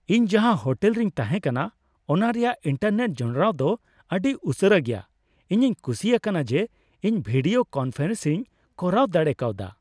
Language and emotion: Santali, happy